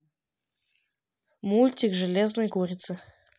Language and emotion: Russian, neutral